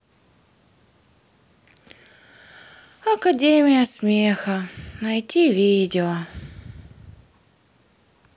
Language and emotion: Russian, sad